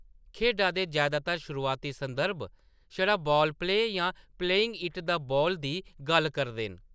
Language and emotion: Dogri, neutral